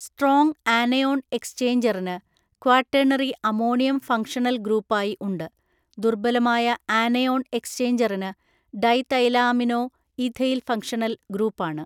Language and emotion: Malayalam, neutral